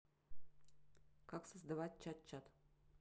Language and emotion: Russian, neutral